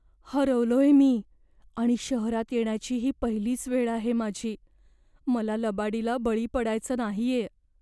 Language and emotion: Marathi, fearful